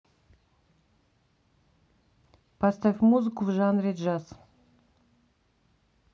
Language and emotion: Russian, neutral